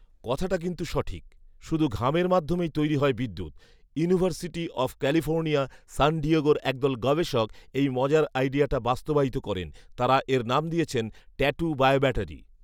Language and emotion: Bengali, neutral